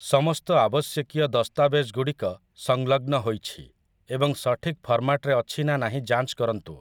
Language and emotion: Odia, neutral